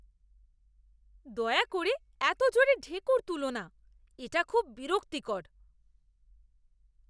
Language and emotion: Bengali, disgusted